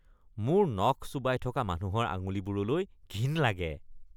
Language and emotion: Assamese, disgusted